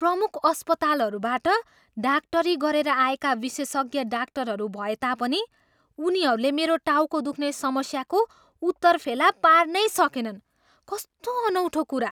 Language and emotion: Nepali, surprised